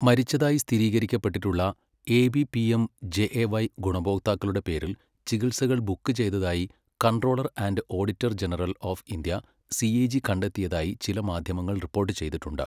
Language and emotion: Malayalam, neutral